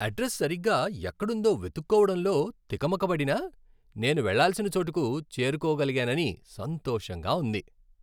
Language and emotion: Telugu, happy